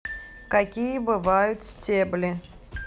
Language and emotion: Russian, neutral